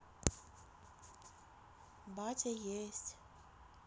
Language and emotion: Russian, neutral